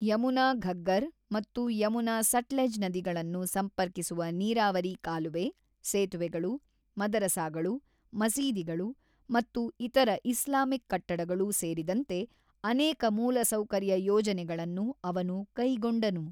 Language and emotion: Kannada, neutral